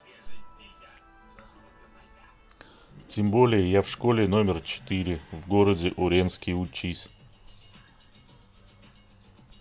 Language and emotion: Russian, neutral